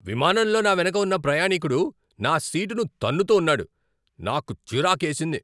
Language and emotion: Telugu, angry